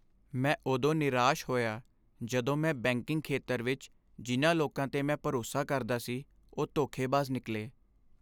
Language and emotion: Punjabi, sad